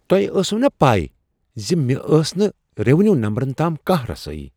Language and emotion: Kashmiri, surprised